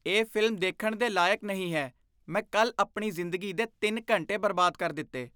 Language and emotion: Punjabi, disgusted